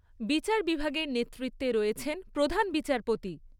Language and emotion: Bengali, neutral